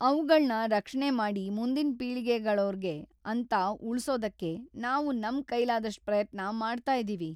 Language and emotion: Kannada, sad